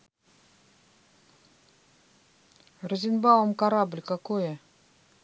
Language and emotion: Russian, neutral